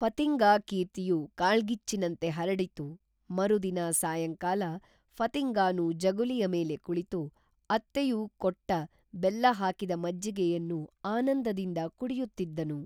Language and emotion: Kannada, neutral